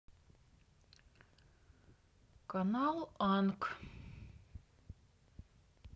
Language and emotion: Russian, neutral